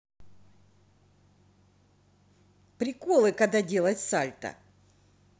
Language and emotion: Russian, positive